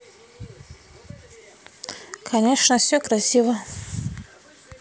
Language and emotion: Russian, neutral